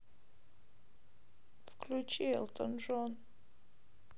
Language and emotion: Russian, sad